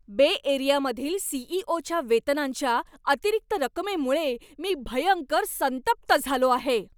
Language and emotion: Marathi, angry